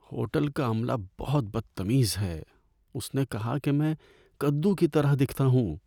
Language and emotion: Urdu, sad